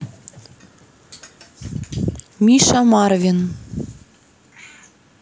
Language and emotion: Russian, neutral